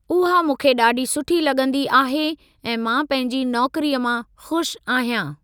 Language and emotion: Sindhi, neutral